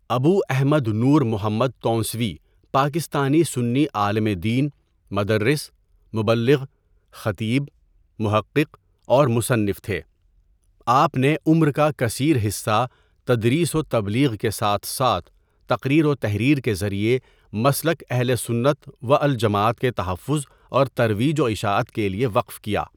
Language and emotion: Urdu, neutral